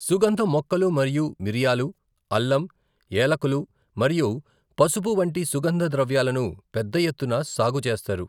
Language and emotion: Telugu, neutral